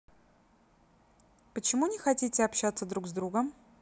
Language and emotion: Russian, neutral